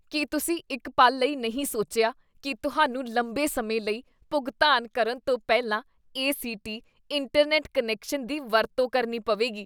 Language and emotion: Punjabi, disgusted